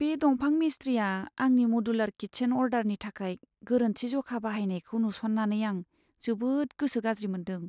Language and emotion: Bodo, sad